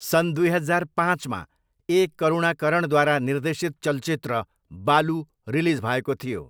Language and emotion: Nepali, neutral